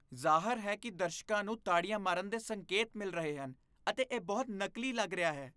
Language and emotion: Punjabi, disgusted